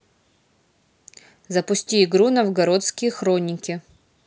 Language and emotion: Russian, neutral